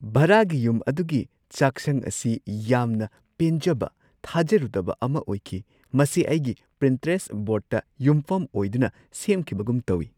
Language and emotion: Manipuri, surprised